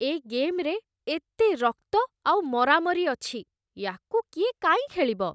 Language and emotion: Odia, disgusted